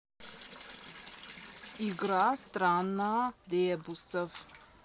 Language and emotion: Russian, neutral